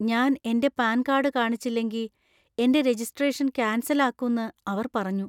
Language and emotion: Malayalam, fearful